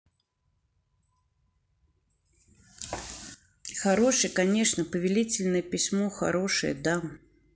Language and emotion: Russian, neutral